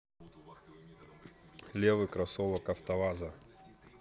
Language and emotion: Russian, neutral